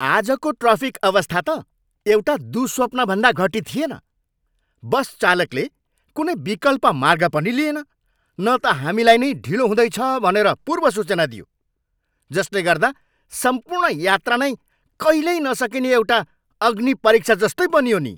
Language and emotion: Nepali, angry